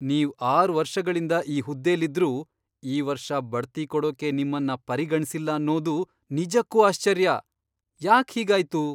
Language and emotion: Kannada, surprised